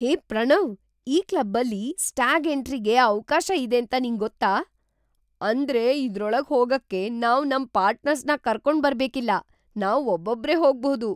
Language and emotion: Kannada, surprised